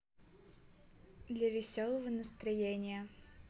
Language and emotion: Russian, positive